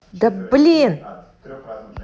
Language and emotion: Russian, angry